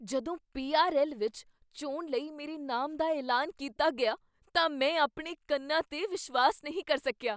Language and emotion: Punjabi, surprised